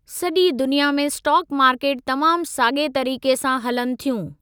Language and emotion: Sindhi, neutral